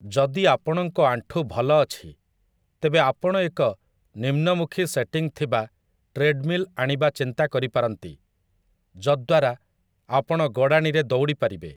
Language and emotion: Odia, neutral